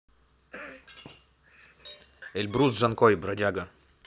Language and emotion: Russian, neutral